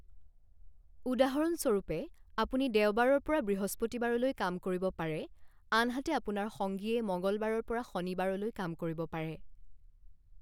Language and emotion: Assamese, neutral